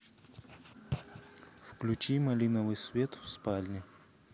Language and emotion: Russian, neutral